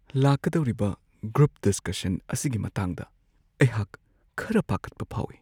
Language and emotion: Manipuri, fearful